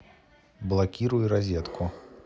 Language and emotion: Russian, neutral